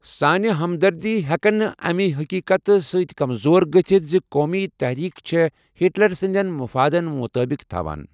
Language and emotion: Kashmiri, neutral